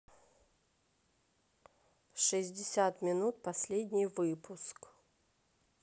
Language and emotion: Russian, neutral